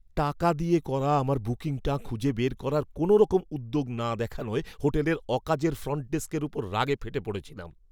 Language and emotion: Bengali, angry